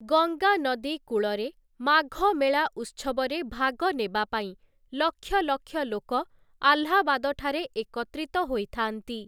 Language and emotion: Odia, neutral